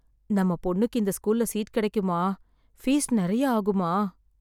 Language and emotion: Tamil, sad